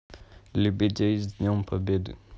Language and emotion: Russian, neutral